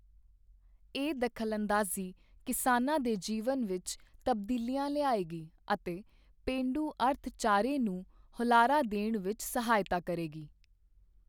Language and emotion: Punjabi, neutral